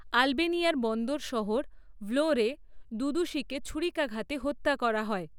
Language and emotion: Bengali, neutral